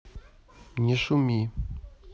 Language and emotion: Russian, neutral